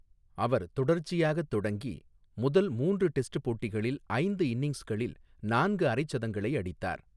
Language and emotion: Tamil, neutral